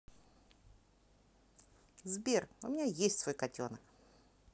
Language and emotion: Russian, positive